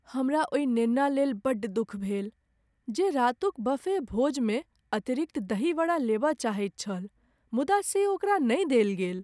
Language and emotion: Maithili, sad